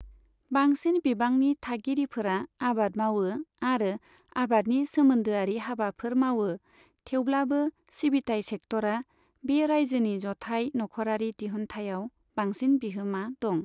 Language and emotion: Bodo, neutral